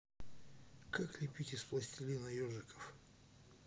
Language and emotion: Russian, neutral